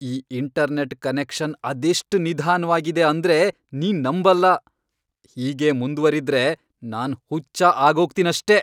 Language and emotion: Kannada, angry